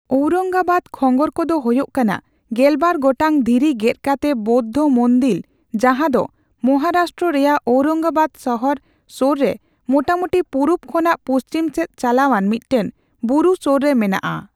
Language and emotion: Santali, neutral